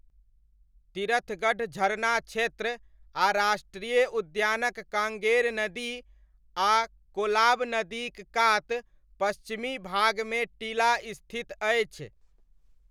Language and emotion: Maithili, neutral